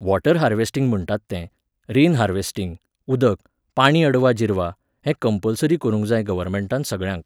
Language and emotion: Goan Konkani, neutral